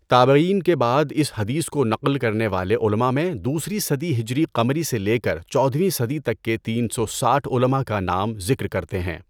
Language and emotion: Urdu, neutral